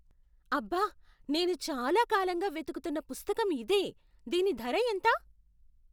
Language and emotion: Telugu, surprised